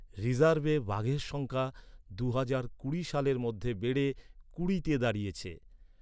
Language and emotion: Bengali, neutral